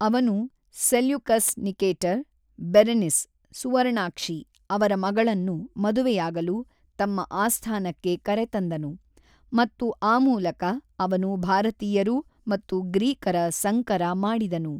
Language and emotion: Kannada, neutral